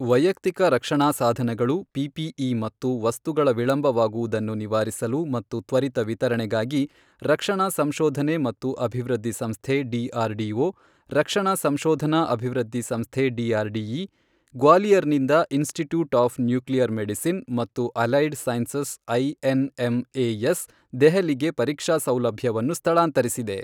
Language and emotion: Kannada, neutral